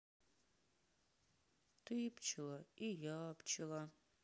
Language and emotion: Russian, sad